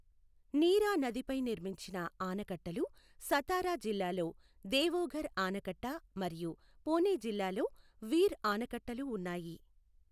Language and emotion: Telugu, neutral